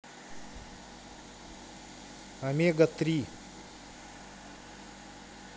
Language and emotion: Russian, neutral